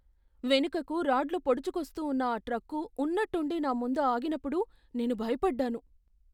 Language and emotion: Telugu, fearful